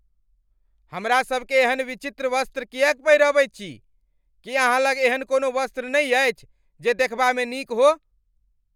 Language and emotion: Maithili, angry